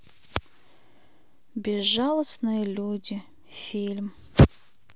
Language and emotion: Russian, sad